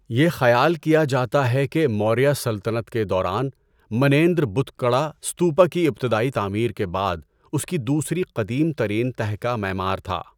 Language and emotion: Urdu, neutral